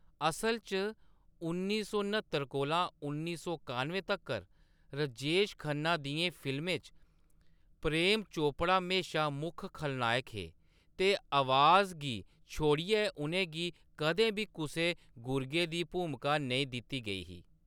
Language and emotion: Dogri, neutral